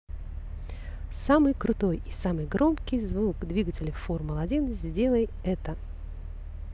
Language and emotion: Russian, positive